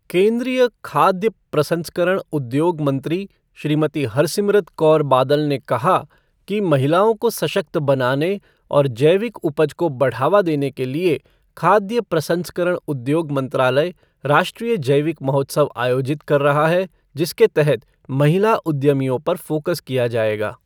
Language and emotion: Hindi, neutral